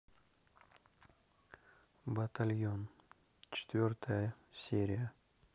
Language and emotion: Russian, neutral